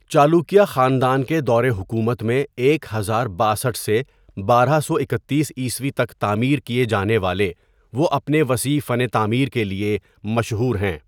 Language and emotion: Urdu, neutral